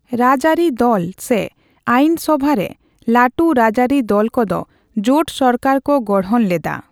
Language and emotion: Santali, neutral